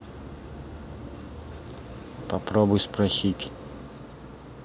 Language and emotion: Russian, neutral